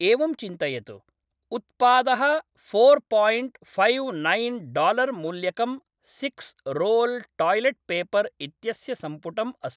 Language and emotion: Sanskrit, neutral